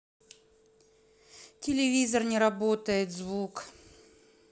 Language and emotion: Russian, sad